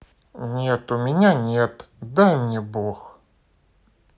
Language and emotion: Russian, sad